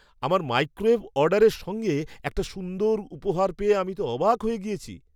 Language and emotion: Bengali, surprised